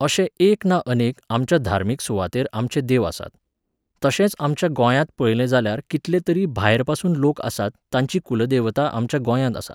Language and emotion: Goan Konkani, neutral